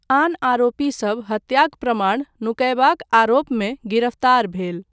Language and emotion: Maithili, neutral